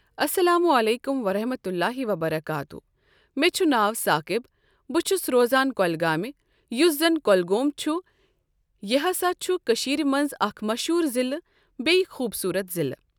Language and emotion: Kashmiri, neutral